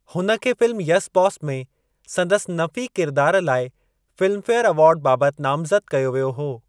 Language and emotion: Sindhi, neutral